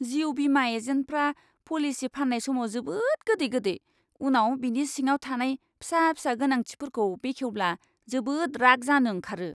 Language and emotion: Bodo, disgusted